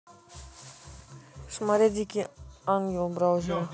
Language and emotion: Russian, neutral